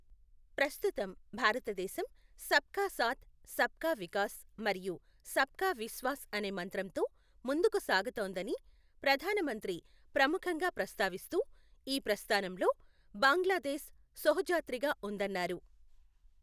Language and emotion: Telugu, neutral